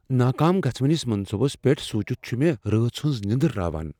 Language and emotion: Kashmiri, fearful